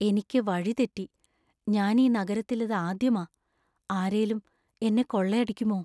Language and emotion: Malayalam, fearful